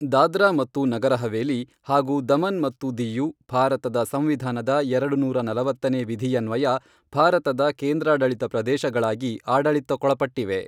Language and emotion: Kannada, neutral